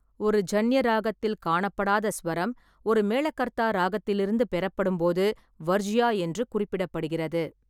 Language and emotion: Tamil, neutral